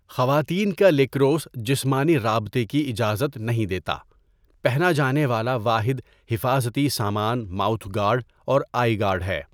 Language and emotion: Urdu, neutral